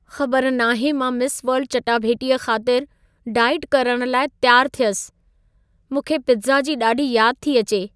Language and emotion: Sindhi, sad